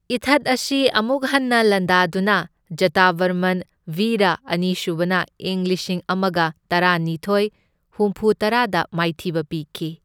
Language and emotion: Manipuri, neutral